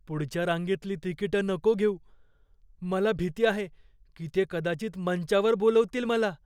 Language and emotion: Marathi, fearful